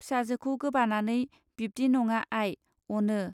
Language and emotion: Bodo, neutral